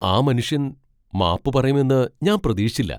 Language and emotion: Malayalam, surprised